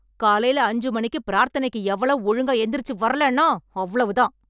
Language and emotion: Tamil, angry